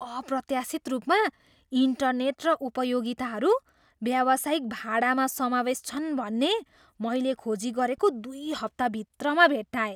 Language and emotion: Nepali, surprised